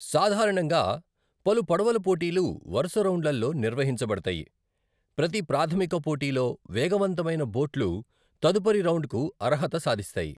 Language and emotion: Telugu, neutral